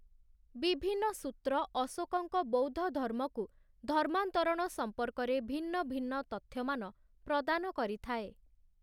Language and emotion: Odia, neutral